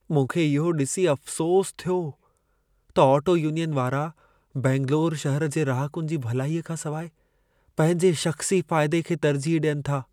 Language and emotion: Sindhi, sad